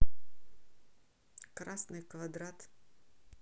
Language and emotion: Russian, neutral